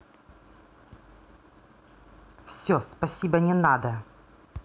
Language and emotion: Russian, angry